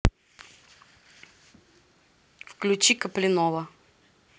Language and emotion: Russian, neutral